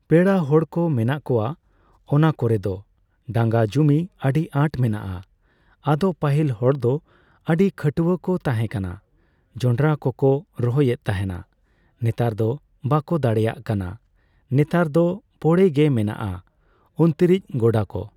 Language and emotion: Santali, neutral